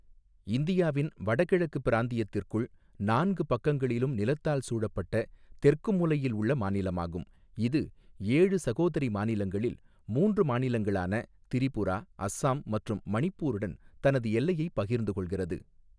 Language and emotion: Tamil, neutral